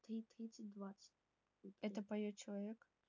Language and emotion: Russian, neutral